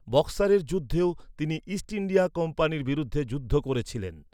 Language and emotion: Bengali, neutral